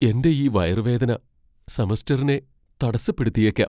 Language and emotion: Malayalam, fearful